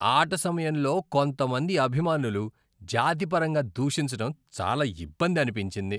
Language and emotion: Telugu, disgusted